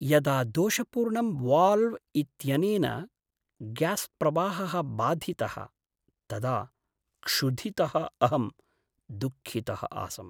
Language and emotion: Sanskrit, sad